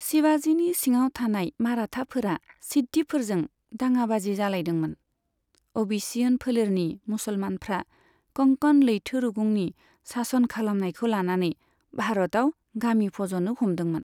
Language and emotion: Bodo, neutral